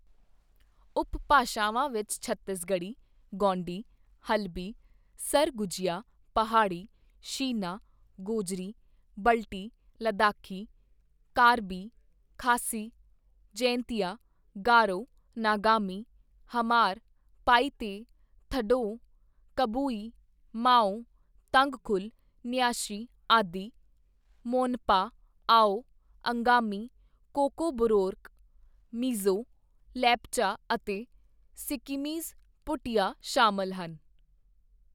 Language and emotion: Punjabi, neutral